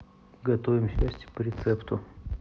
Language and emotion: Russian, neutral